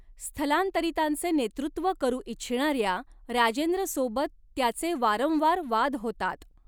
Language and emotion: Marathi, neutral